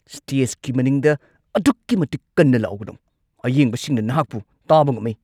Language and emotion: Manipuri, angry